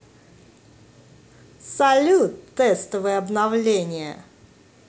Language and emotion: Russian, positive